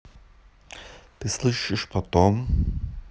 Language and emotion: Russian, neutral